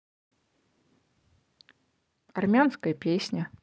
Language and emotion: Russian, neutral